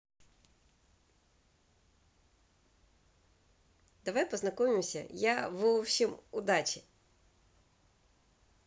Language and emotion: Russian, positive